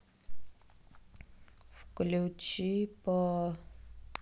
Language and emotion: Russian, sad